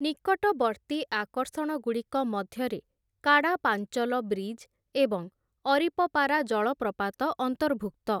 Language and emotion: Odia, neutral